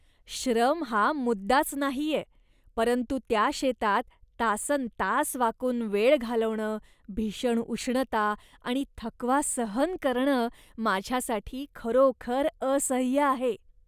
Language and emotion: Marathi, disgusted